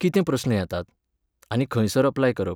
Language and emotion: Goan Konkani, neutral